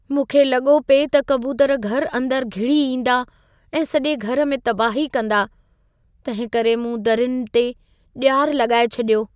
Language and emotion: Sindhi, fearful